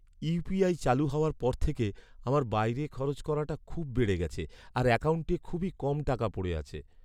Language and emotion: Bengali, sad